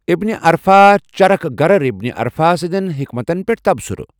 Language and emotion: Kashmiri, neutral